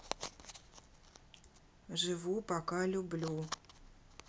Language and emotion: Russian, neutral